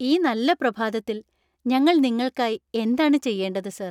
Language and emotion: Malayalam, happy